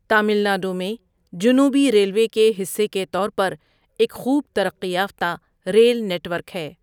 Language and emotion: Urdu, neutral